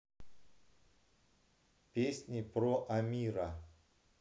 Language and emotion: Russian, neutral